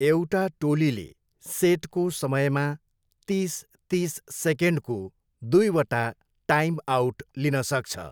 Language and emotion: Nepali, neutral